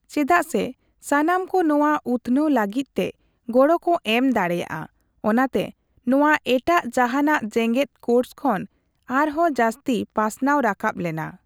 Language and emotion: Santali, neutral